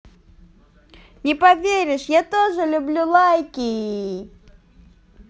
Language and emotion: Russian, positive